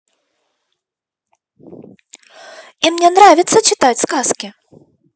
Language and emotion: Russian, positive